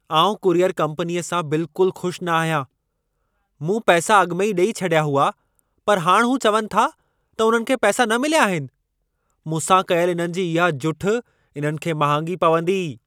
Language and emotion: Sindhi, angry